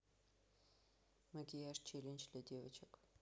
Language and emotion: Russian, neutral